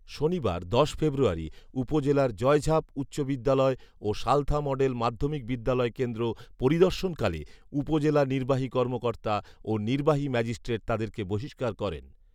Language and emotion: Bengali, neutral